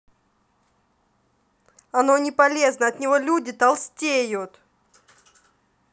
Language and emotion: Russian, angry